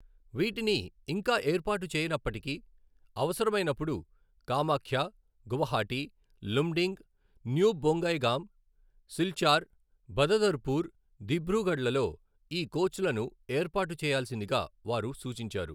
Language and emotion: Telugu, neutral